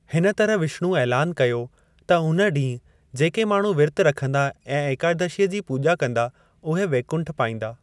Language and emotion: Sindhi, neutral